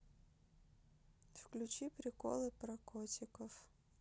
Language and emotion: Russian, neutral